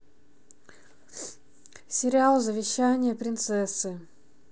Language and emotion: Russian, neutral